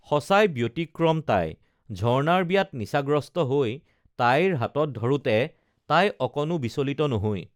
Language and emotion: Assamese, neutral